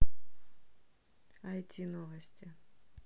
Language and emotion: Russian, neutral